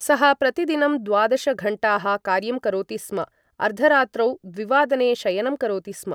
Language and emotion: Sanskrit, neutral